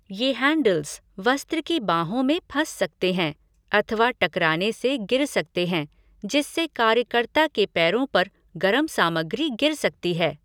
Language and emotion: Hindi, neutral